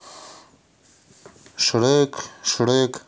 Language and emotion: Russian, neutral